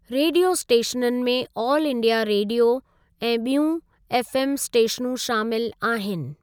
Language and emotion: Sindhi, neutral